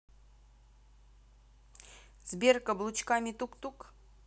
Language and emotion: Russian, neutral